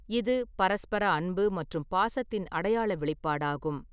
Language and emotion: Tamil, neutral